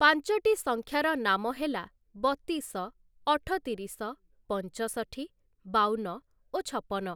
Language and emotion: Odia, neutral